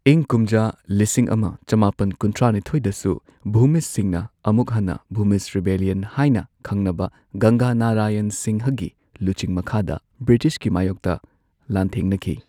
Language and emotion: Manipuri, neutral